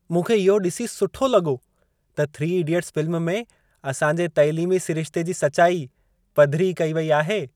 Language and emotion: Sindhi, happy